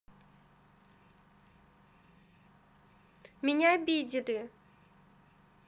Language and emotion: Russian, sad